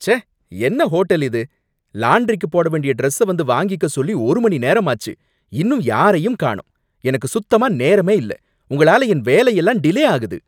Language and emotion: Tamil, angry